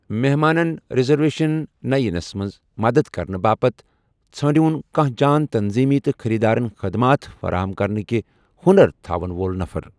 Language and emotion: Kashmiri, neutral